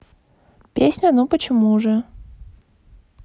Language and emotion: Russian, neutral